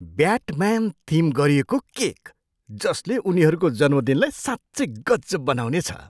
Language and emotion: Nepali, surprised